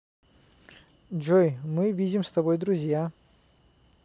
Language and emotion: Russian, positive